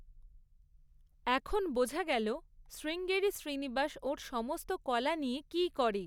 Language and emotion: Bengali, neutral